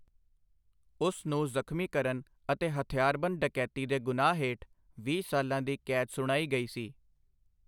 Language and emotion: Punjabi, neutral